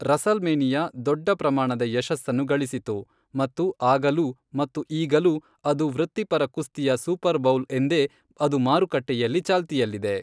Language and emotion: Kannada, neutral